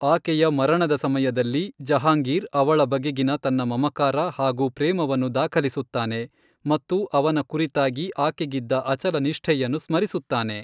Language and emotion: Kannada, neutral